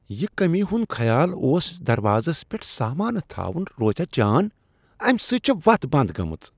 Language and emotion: Kashmiri, disgusted